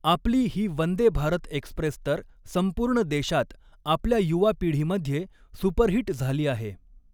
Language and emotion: Marathi, neutral